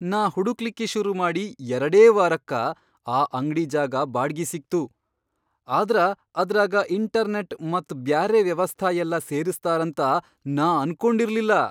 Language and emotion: Kannada, surprised